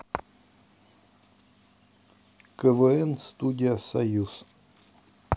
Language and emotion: Russian, neutral